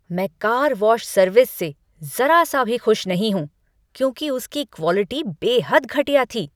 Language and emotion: Hindi, angry